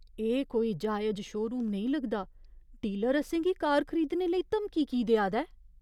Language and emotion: Dogri, fearful